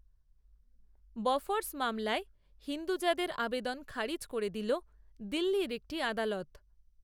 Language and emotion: Bengali, neutral